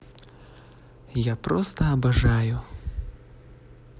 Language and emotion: Russian, neutral